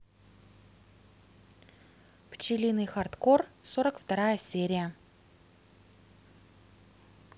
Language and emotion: Russian, neutral